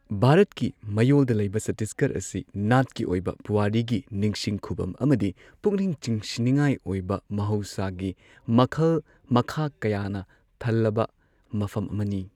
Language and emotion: Manipuri, neutral